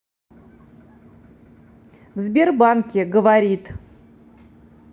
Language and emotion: Russian, neutral